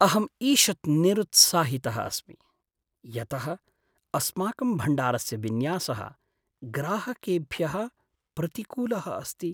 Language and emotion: Sanskrit, sad